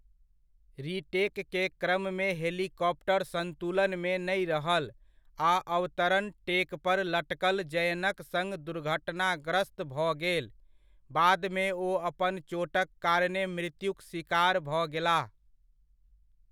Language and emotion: Maithili, neutral